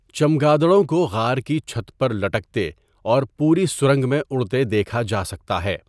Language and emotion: Urdu, neutral